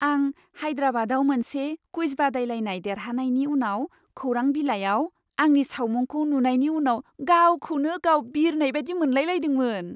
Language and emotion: Bodo, happy